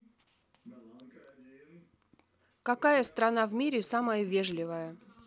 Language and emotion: Russian, neutral